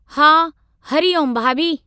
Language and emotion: Sindhi, neutral